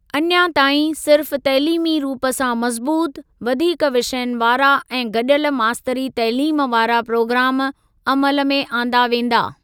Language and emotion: Sindhi, neutral